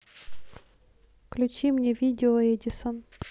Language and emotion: Russian, neutral